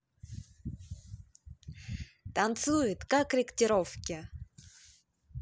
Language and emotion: Russian, positive